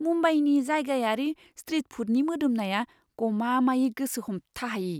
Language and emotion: Bodo, surprised